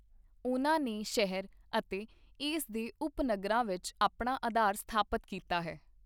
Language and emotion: Punjabi, neutral